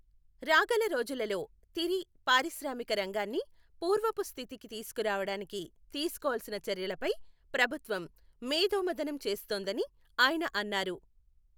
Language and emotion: Telugu, neutral